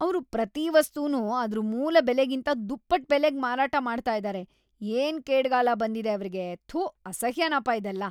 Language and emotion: Kannada, disgusted